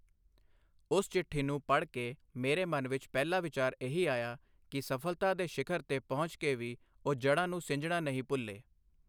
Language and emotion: Punjabi, neutral